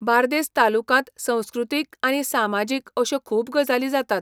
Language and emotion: Goan Konkani, neutral